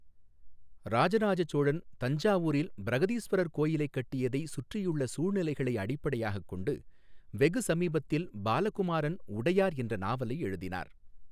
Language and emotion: Tamil, neutral